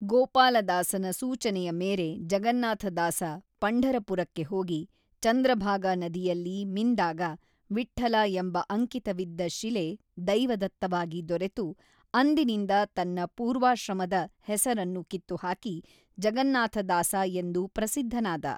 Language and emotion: Kannada, neutral